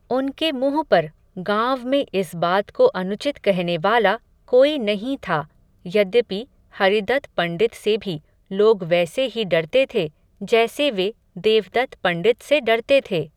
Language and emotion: Hindi, neutral